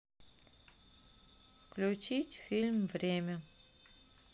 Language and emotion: Russian, neutral